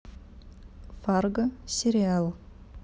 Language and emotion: Russian, neutral